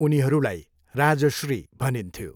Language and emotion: Nepali, neutral